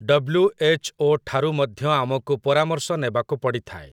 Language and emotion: Odia, neutral